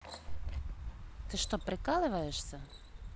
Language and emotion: Russian, neutral